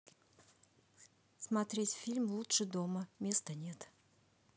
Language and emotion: Russian, neutral